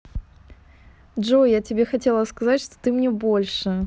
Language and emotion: Russian, positive